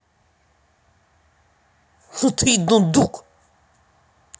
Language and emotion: Russian, angry